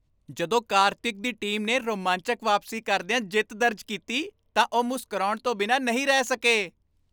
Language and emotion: Punjabi, happy